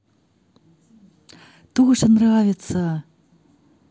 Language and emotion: Russian, positive